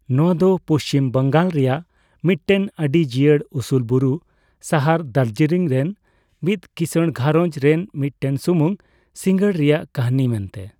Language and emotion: Santali, neutral